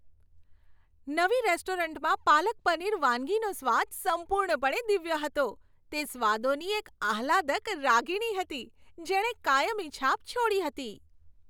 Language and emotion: Gujarati, happy